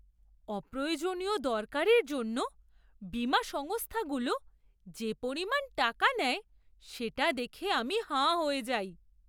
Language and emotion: Bengali, surprised